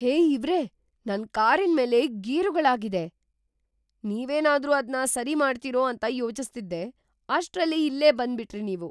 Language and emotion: Kannada, surprised